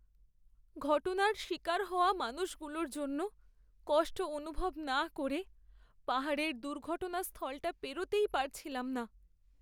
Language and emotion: Bengali, sad